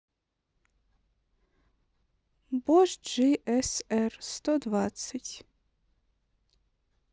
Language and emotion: Russian, neutral